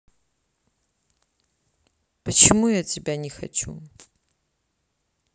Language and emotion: Russian, sad